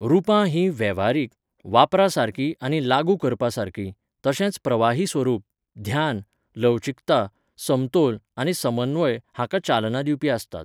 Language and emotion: Goan Konkani, neutral